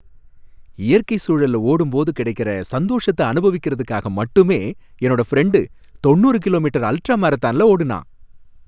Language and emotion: Tamil, happy